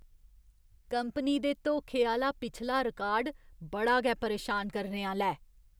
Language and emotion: Dogri, disgusted